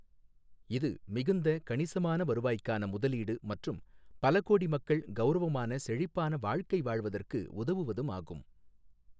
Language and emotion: Tamil, neutral